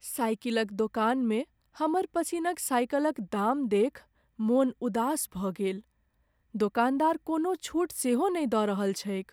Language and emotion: Maithili, sad